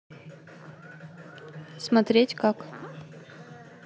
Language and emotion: Russian, neutral